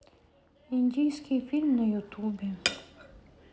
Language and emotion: Russian, sad